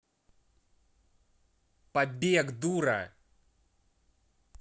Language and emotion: Russian, angry